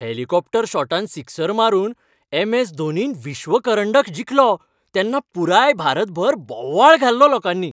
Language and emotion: Goan Konkani, happy